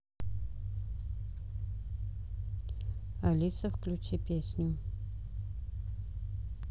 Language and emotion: Russian, neutral